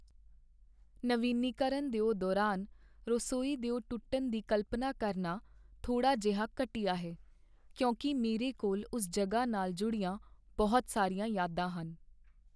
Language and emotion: Punjabi, sad